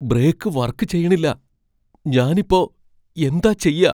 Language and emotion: Malayalam, fearful